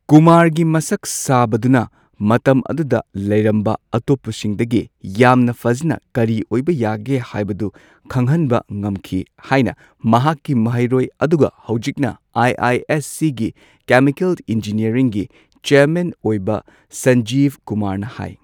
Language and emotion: Manipuri, neutral